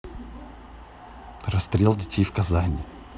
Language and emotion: Russian, neutral